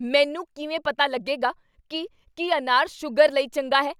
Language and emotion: Punjabi, angry